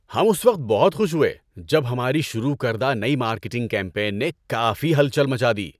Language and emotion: Urdu, happy